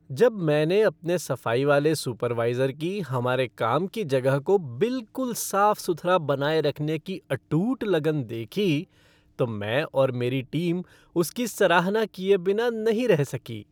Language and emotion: Hindi, happy